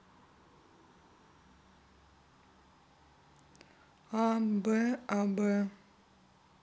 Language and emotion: Russian, neutral